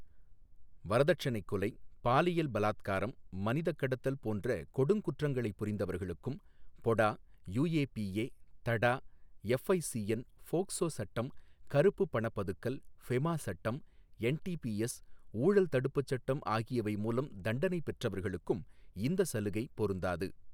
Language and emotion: Tamil, neutral